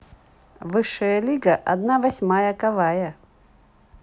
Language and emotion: Russian, positive